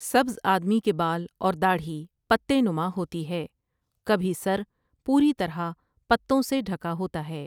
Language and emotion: Urdu, neutral